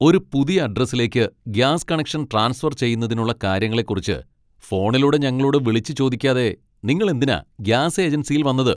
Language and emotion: Malayalam, angry